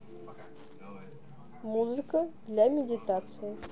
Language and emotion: Russian, neutral